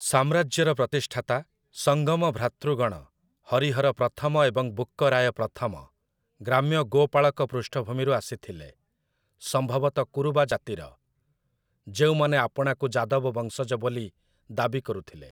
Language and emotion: Odia, neutral